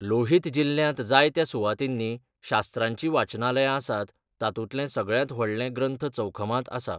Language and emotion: Goan Konkani, neutral